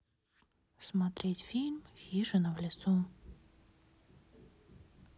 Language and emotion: Russian, neutral